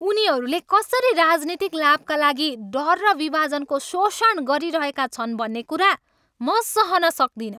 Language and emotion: Nepali, angry